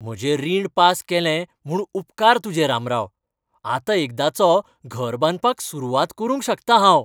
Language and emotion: Goan Konkani, happy